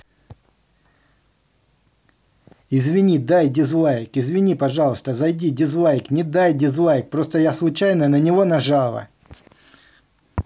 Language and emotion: Russian, angry